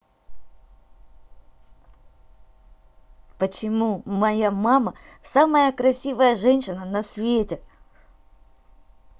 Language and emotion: Russian, positive